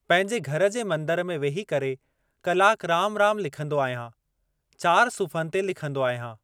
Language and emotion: Sindhi, neutral